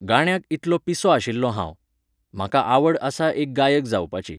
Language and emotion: Goan Konkani, neutral